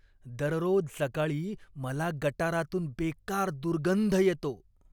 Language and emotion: Marathi, disgusted